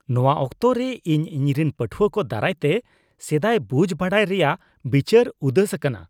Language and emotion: Santali, disgusted